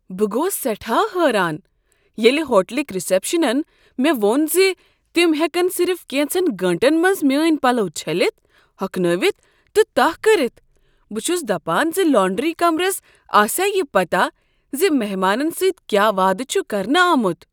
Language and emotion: Kashmiri, surprised